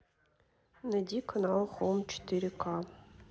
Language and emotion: Russian, neutral